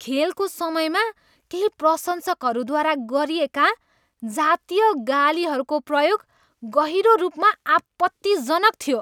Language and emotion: Nepali, disgusted